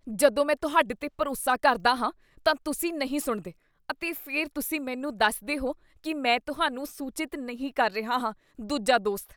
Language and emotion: Punjabi, disgusted